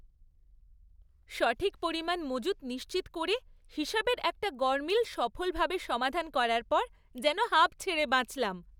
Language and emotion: Bengali, happy